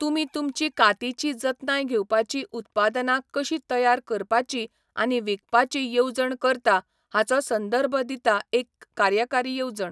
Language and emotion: Goan Konkani, neutral